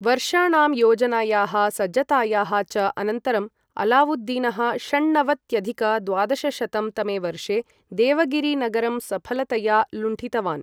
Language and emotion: Sanskrit, neutral